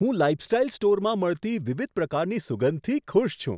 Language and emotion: Gujarati, surprised